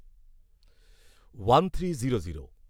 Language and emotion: Bengali, neutral